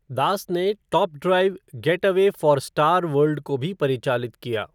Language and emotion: Hindi, neutral